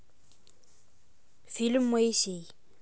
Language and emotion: Russian, neutral